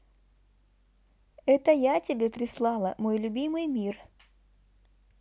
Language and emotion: Russian, positive